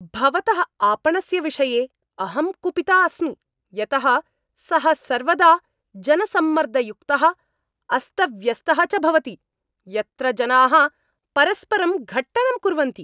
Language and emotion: Sanskrit, angry